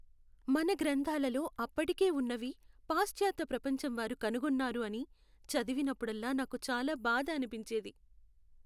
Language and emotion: Telugu, sad